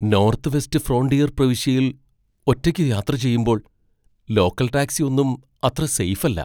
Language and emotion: Malayalam, fearful